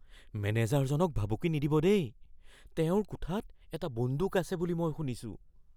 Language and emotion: Assamese, fearful